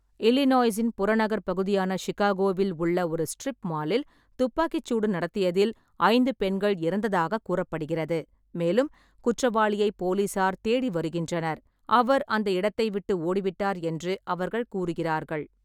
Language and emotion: Tamil, neutral